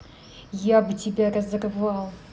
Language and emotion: Russian, angry